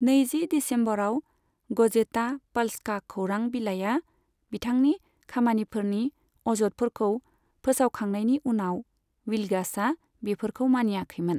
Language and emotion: Bodo, neutral